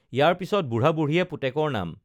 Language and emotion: Assamese, neutral